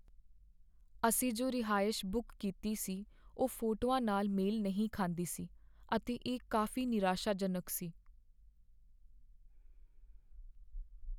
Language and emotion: Punjabi, sad